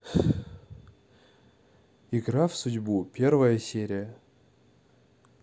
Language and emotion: Russian, neutral